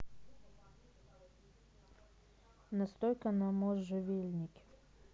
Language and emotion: Russian, neutral